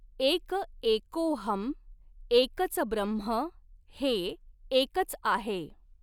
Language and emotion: Marathi, neutral